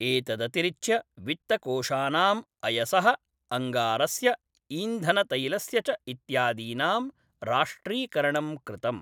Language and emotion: Sanskrit, neutral